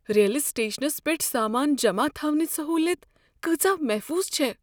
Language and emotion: Kashmiri, fearful